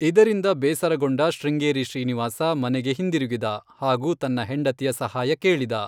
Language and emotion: Kannada, neutral